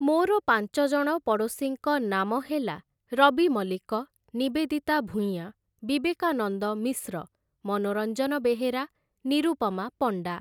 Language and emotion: Odia, neutral